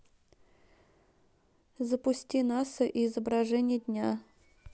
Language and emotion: Russian, neutral